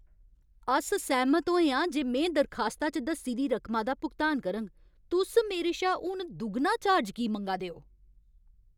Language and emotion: Dogri, angry